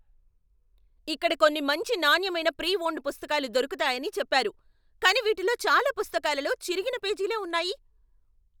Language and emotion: Telugu, angry